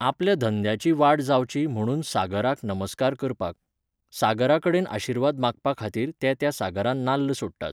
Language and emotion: Goan Konkani, neutral